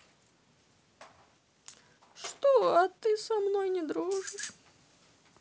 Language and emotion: Russian, sad